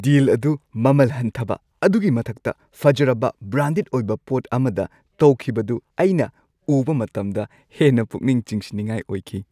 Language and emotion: Manipuri, happy